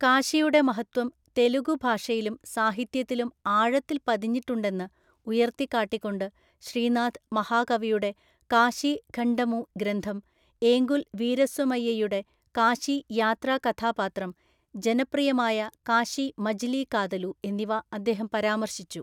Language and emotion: Malayalam, neutral